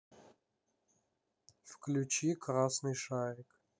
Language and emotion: Russian, sad